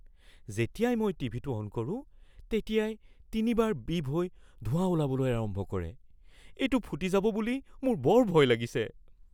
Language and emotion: Assamese, fearful